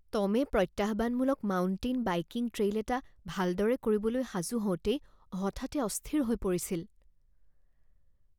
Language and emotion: Assamese, fearful